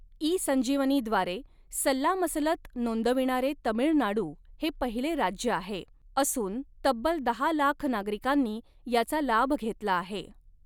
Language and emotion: Marathi, neutral